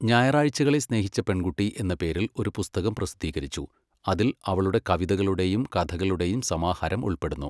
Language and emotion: Malayalam, neutral